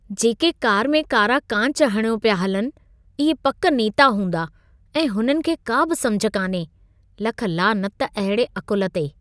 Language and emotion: Sindhi, disgusted